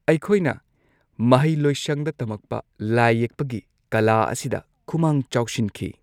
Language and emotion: Manipuri, neutral